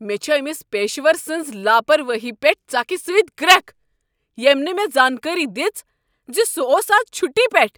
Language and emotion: Kashmiri, angry